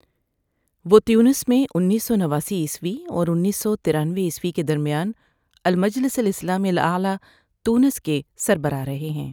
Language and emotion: Urdu, neutral